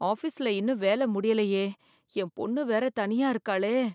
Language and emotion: Tamil, fearful